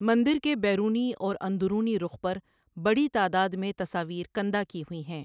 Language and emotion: Urdu, neutral